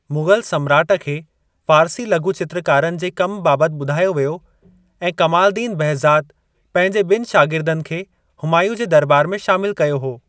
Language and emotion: Sindhi, neutral